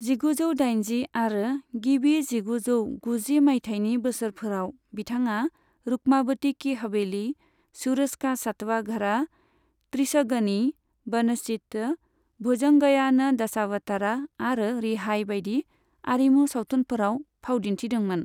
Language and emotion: Bodo, neutral